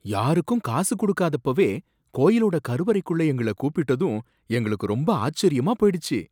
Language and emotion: Tamil, surprised